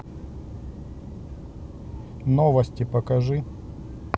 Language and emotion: Russian, neutral